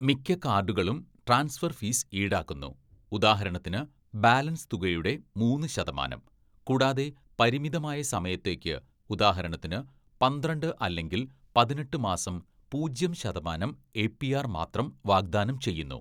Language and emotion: Malayalam, neutral